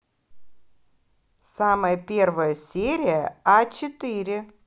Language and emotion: Russian, positive